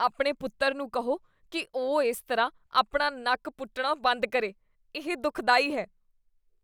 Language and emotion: Punjabi, disgusted